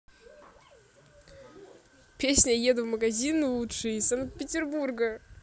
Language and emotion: Russian, positive